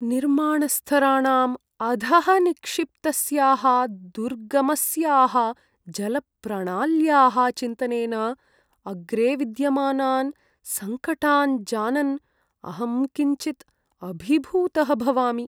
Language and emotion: Sanskrit, sad